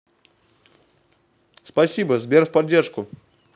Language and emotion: Russian, positive